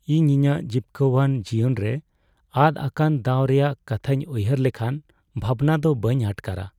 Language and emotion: Santali, sad